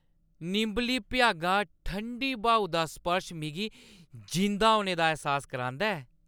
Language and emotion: Dogri, happy